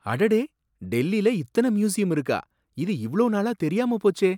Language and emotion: Tamil, surprised